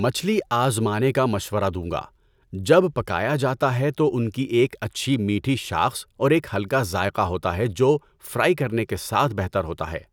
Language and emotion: Urdu, neutral